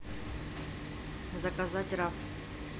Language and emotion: Russian, neutral